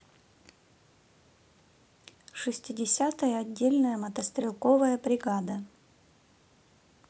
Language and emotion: Russian, neutral